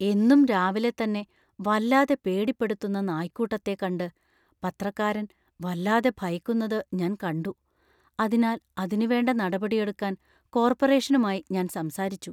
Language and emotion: Malayalam, fearful